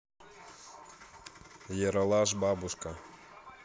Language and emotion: Russian, neutral